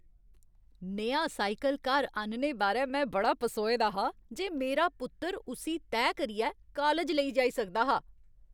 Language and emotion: Dogri, happy